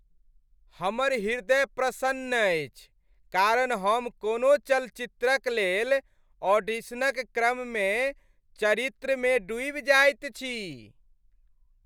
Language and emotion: Maithili, happy